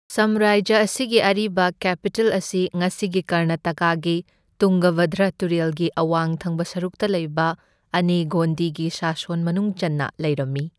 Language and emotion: Manipuri, neutral